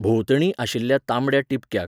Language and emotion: Goan Konkani, neutral